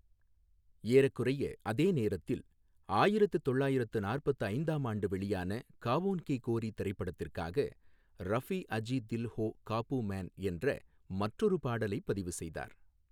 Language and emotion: Tamil, neutral